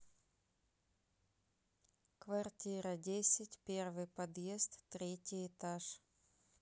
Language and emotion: Russian, neutral